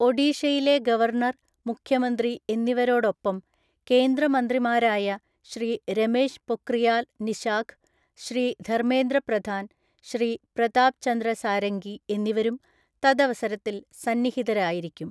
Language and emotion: Malayalam, neutral